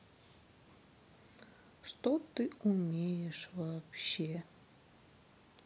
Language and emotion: Russian, sad